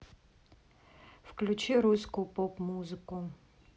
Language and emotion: Russian, neutral